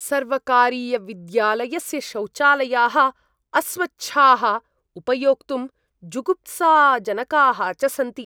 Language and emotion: Sanskrit, disgusted